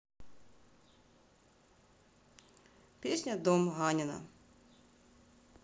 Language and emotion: Russian, neutral